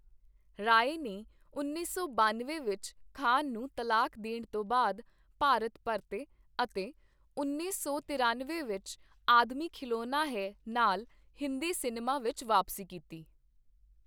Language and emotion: Punjabi, neutral